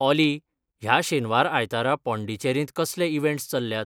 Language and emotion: Goan Konkani, neutral